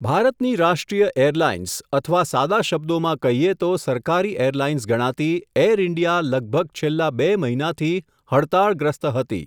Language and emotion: Gujarati, neutral